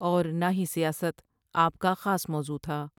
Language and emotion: Urdu, neutral